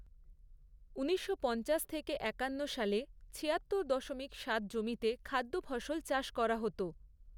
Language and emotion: Bengali, neutral